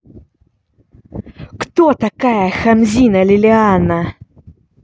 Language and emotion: Russian, angry